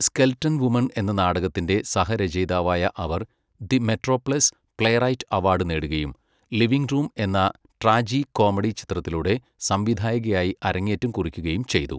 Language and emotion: Malayalam, neutral